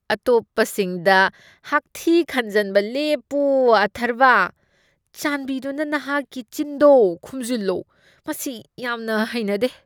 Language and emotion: Manipuri, disgusted